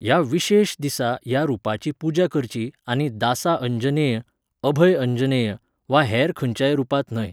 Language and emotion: Goan Konkani, neutral